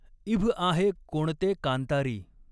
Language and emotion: Marathi, neutral